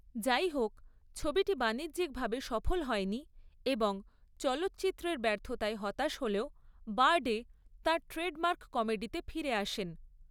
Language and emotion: Bengali, neutral